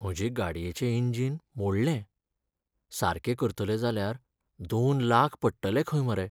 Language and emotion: Goan Konkani, sad